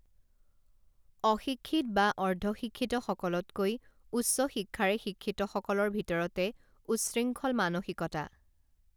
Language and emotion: Assamese, neutral